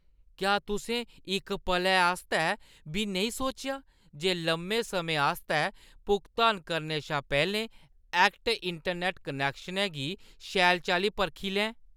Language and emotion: Dogri, disgusted